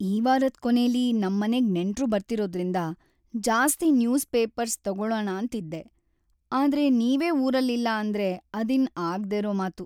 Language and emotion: Kannada, sad